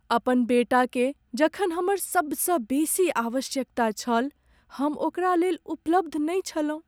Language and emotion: Maithili, sad